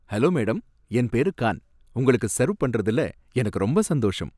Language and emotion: Tamil, happy